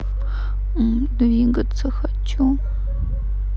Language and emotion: Russian, sad